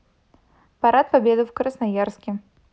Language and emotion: Russian, neutral